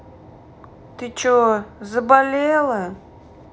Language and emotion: Russian, angry